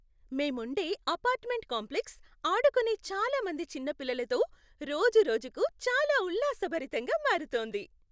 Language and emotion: Telugu, happy